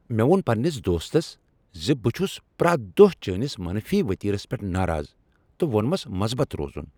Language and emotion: Kashmiri, angry